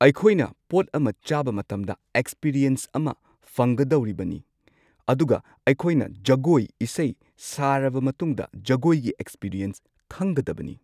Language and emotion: Manipuri, neutral